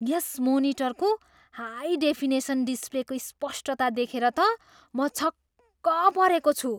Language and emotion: Nepali, surprised